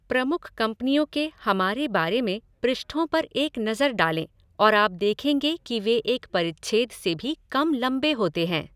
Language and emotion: Hindi, neutral